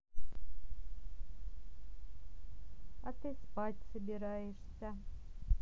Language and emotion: Russian, neutral